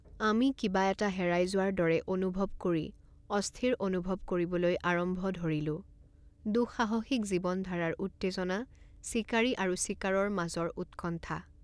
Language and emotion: Assamese, neutral